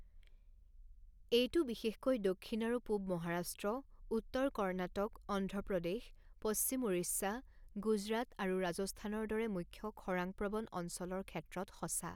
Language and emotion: Assamese, neutral